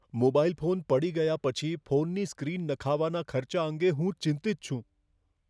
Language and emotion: Gujarati, fearful